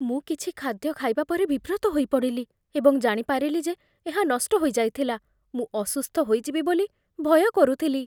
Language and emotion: Odia, fearful